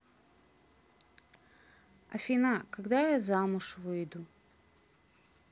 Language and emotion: Russian, sad